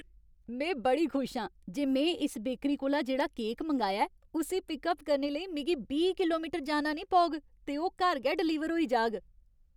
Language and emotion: Dogri, happy